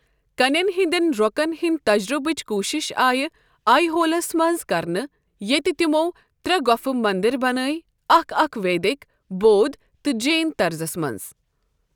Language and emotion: Kashmiri, neutral